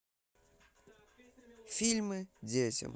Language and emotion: Russian, neutral